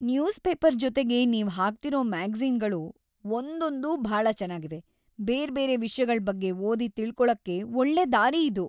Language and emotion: Kannada, happy